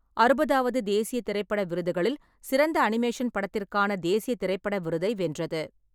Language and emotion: Tamil, neutral